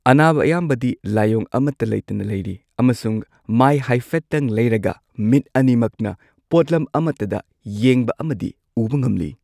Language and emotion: Manipuri, neutral